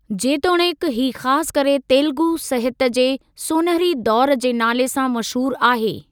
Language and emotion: Sindhi, neutral